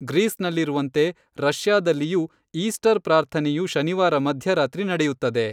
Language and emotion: Kannada, neutral